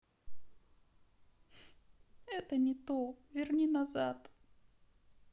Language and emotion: Russian, sad